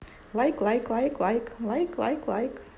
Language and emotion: Russian, positive